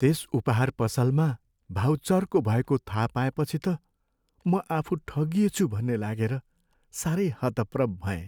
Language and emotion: Nepali, sad